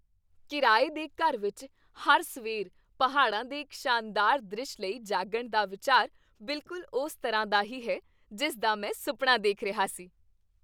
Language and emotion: Punjabi, happy